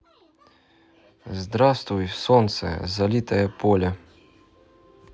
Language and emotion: Russian, neutral